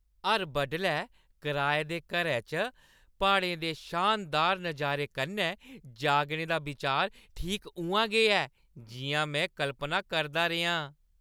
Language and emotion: Dogri, happy